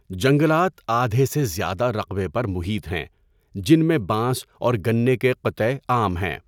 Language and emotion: Urdu, neutral